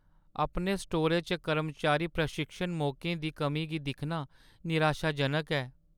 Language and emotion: Dogri, sad